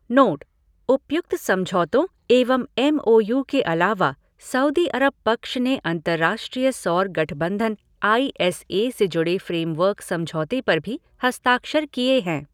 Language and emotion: Hindi, neutral